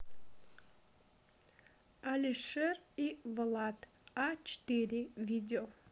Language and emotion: Russian, neutral